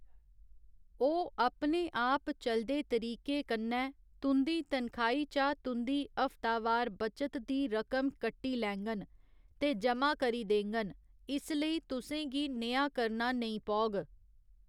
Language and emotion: Dogri, neutral